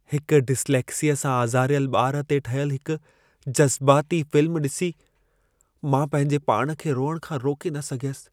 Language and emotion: Sindhi, sad